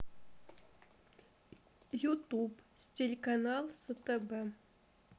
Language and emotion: Russian, neutral